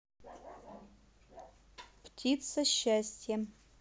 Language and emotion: Russian, neutral